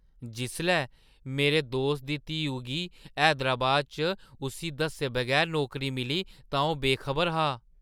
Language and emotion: Dogri, surprised